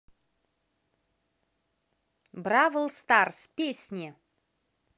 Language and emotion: Russian, positive